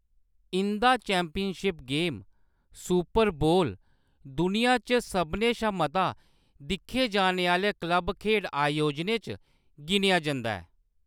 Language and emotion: Dogri, neutral